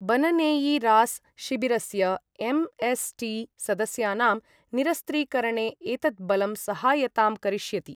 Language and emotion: Sanskrit, neutral